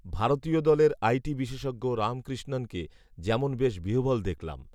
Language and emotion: Bengali, neutral